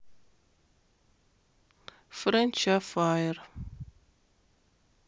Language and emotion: Russian, neutral